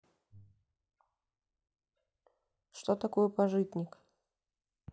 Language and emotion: Russian, neutral